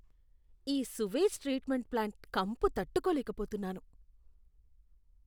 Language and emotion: Telugu, disgusted